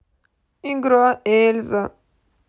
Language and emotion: Russian, sad